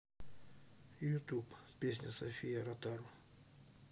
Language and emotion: Russian, neutral